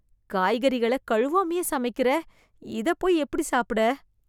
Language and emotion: Tamil, disgusted